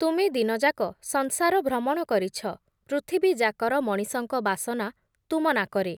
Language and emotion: Odia, neutral